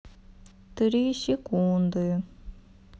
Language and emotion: Russian, sad